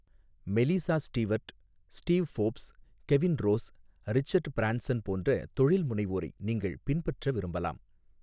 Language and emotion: Tamil, neutral